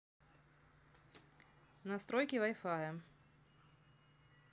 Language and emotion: Russian, neutral